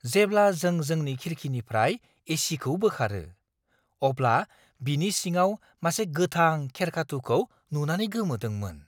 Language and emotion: Bodo, surprised